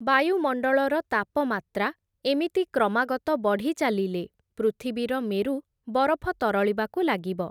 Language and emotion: Odia, neutral